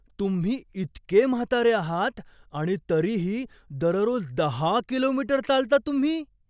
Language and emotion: Marathi, surprised